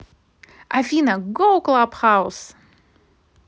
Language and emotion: Russian, positive